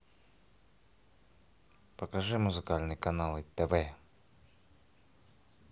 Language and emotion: Russian, neutral